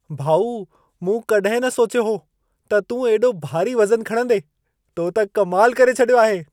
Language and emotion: Sindhi, surprised